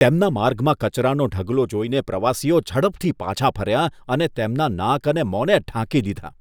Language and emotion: Gujarati, disgusted